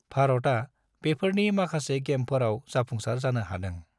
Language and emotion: Bodo, neutral